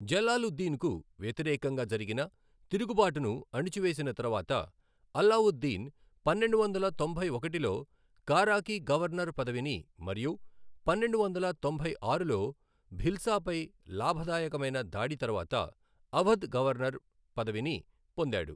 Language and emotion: Telugu, neutral